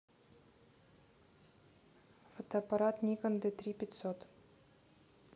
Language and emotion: Russian, neutral